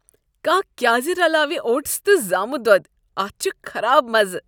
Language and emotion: Kashmiri, disgusted